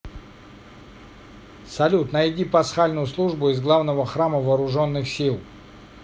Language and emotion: Russian, neutral